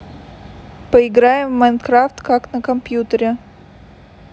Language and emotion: Russian, neutral